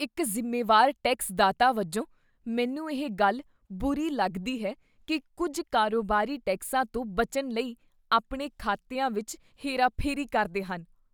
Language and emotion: Punjabi, disgusted